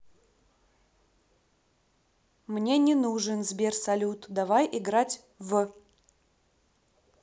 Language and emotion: Russian, angry